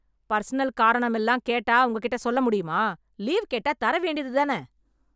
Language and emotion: Tamil, angry